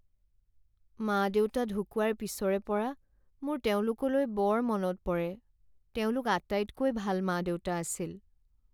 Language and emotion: Assamese, sad